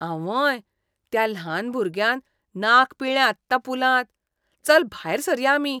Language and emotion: Goan Konkani, disgusted